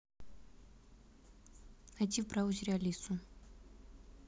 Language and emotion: Russian, neutral